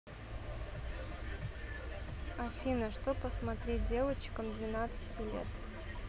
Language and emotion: Russian, neutral